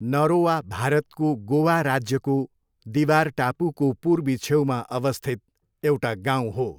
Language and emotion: Nepali, neutral